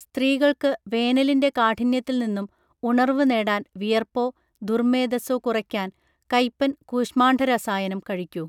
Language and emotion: Malayalam, neutral